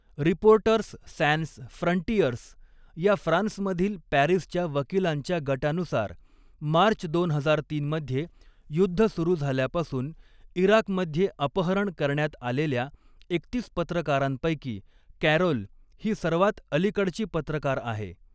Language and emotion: Marathi, neutral